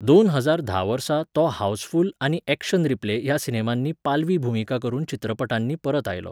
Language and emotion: Goan Konkani, neutral